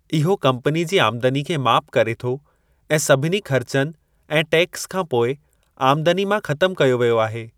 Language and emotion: Sindhi, neutral